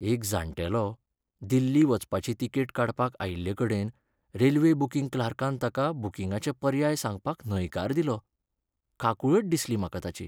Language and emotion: Goan Konkani, sad